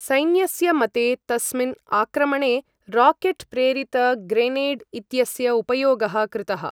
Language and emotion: Sanskrit, neutral